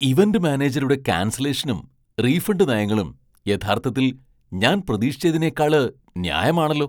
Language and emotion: Malayalam, surprised